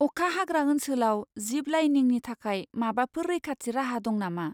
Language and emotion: Bodo, fearful